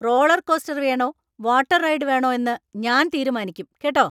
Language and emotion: Malayalam, angry